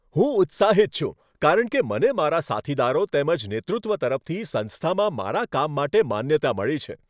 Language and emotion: Gujarati, happy